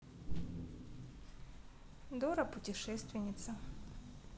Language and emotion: Russian, neutral